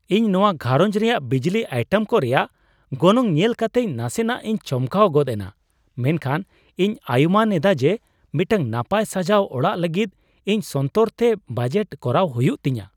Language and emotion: Santali, surprised